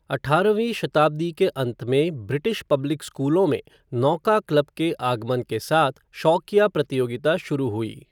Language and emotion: Hindi, neutral